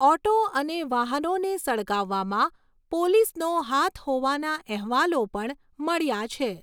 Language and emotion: Gujarati, neutral